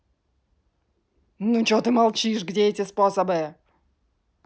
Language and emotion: Russian, angry